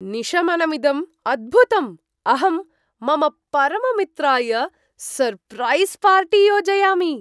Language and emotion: Sanskrit, surprised